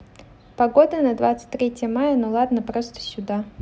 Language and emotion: Russian, neutral